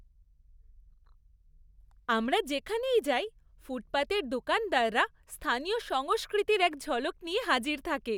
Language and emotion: Bengali, happy